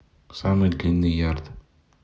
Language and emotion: Russian, neutral